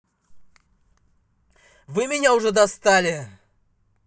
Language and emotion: Russian, angry